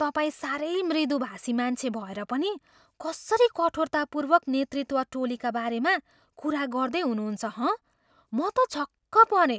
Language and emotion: Nepali, surprised